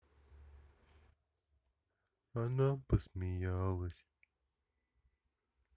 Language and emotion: Russian, sad